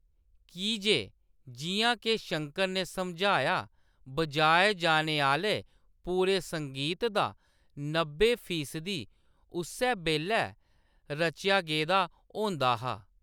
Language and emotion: Dogri, neutral